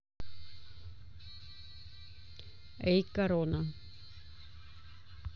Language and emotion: Russian, neutral